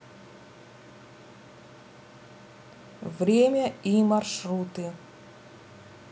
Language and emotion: Russian, neutral